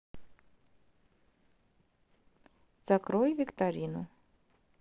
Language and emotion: Russian, neutral